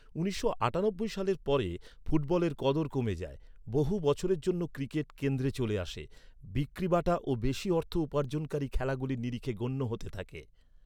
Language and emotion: Bengali, neutral